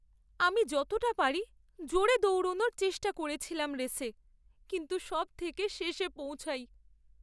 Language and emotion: Bengali, sad